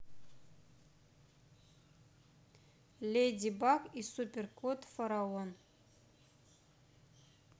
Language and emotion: Russian, neutral